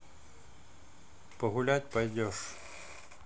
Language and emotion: Russian, neutral